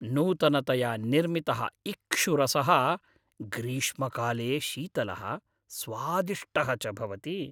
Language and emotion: Sanskrit, happy